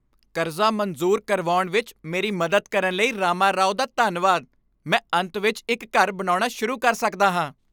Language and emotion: Punjabi, happy